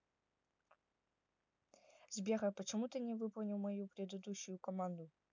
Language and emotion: Russian, neutral